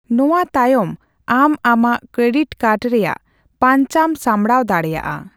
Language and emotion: Santali, neutral